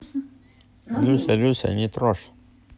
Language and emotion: Russian, neutral